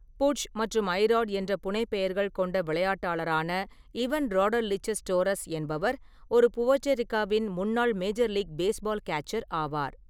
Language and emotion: Tamil, neutral